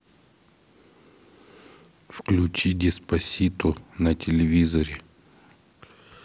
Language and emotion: Russian, neutral